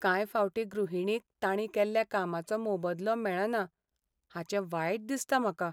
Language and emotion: Goan Konkani, sad